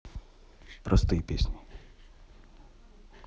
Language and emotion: Russian, neutral